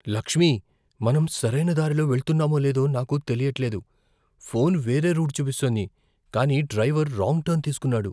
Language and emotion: Telugu, fearful